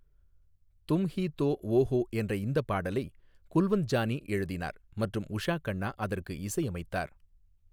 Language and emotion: Tamil, neutral